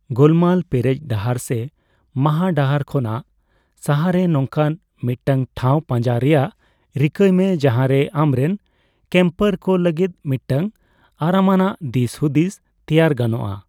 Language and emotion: Santali, neutral